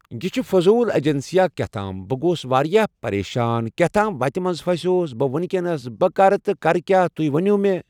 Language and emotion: Kashmiri, neutral